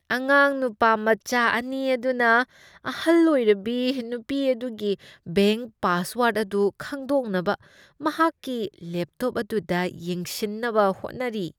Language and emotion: Manipuri, disgusted